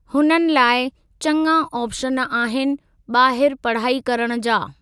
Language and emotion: Sindhi, neutral